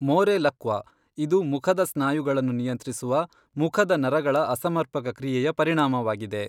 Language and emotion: Kannada, neutral